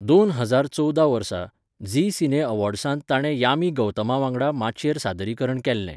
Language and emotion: Goan Konkani, neutral